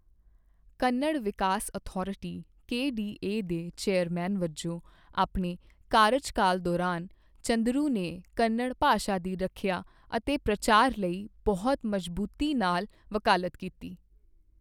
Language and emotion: Punjabi, neutral